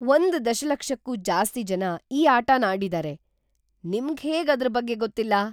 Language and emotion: Kannada, surprised